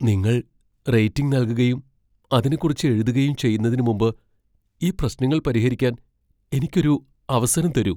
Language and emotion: Malayalam, fearful